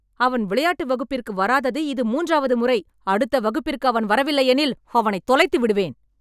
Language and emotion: Tamil, angry